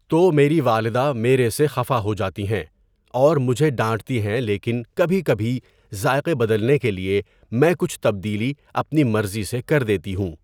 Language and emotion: Urdu, neutral